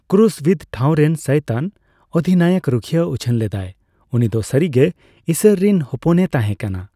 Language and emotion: Santali, neutral